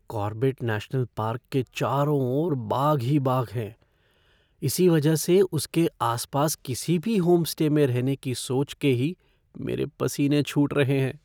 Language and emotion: Hindi, fearful